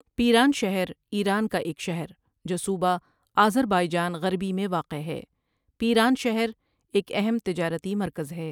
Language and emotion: Urdu, neutral